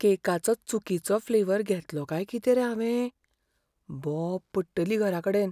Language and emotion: Goan Konkani, fearful